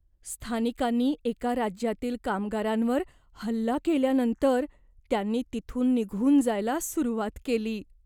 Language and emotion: Marathi, fearful